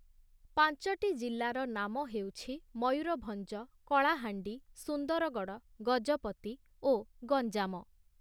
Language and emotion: Odia, neutral